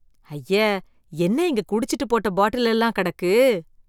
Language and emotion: Tamil, disgusted